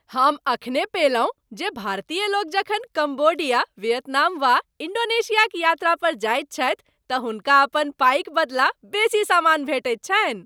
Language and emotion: Maithili, happy